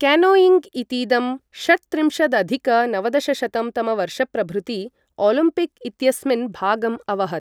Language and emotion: Sanskrit, neutral